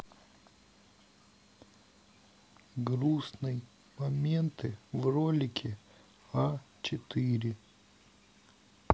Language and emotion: Russian, sad